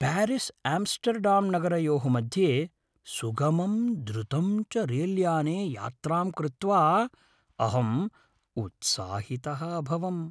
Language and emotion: Sanskrit, happy